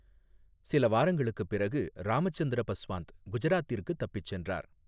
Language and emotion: Tamil, neutral